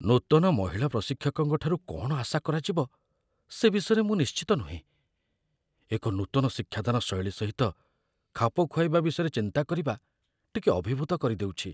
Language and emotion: Odia, fearful